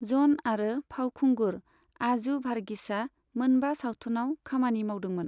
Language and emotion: Bodo, neutral